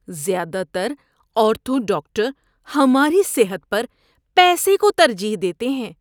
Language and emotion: Urdu, disgusted